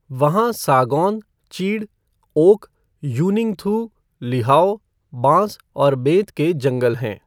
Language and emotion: Hindi, neutral